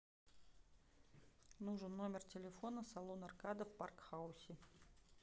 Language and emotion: Russian, neutral